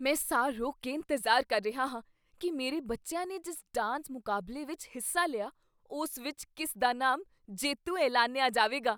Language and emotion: Punjabi, surprised